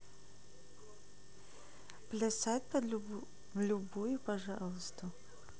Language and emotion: Russian, neutral